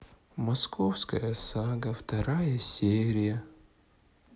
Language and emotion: Russian, sad